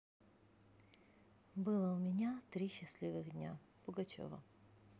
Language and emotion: Russian, neutral